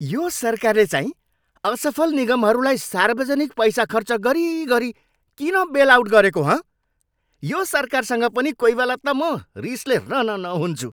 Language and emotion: Nepali, angry